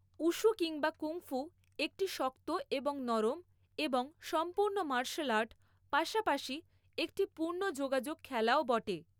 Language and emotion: Bengali, neutral